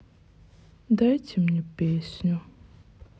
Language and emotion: Russian, sad